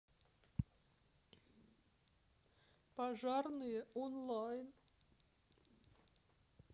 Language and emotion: Russian, sad